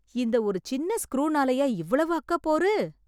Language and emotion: Tamil, surprised